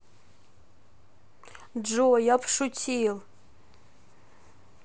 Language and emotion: Russian, neutral